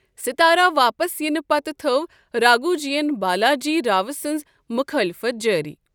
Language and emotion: Kashmiri, neutral